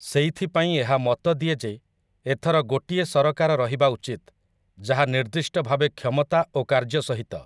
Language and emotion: Odia, neutral